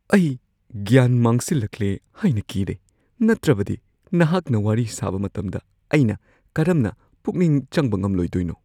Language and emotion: Manipuri, fearful